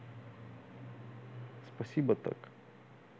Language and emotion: Russian, neutral